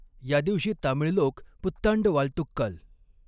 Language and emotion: Marathi, neutral